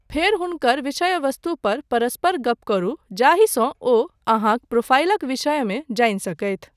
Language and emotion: Maithili, neutral